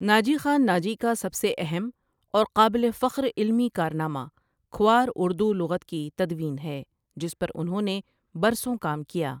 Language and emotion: Urdu, neutral